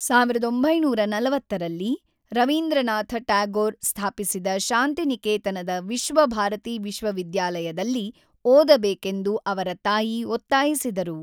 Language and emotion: Kannada, neutral